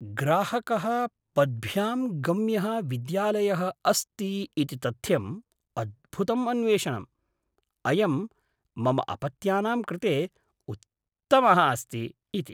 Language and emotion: Sanskrit, surprised